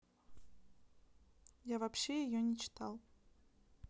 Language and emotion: Russian, neutral